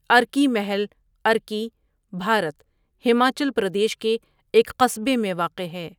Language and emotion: Urdu, neutral